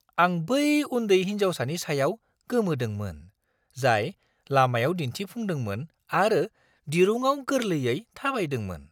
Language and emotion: Bodo, surprised